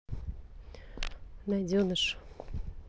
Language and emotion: Russian, neutral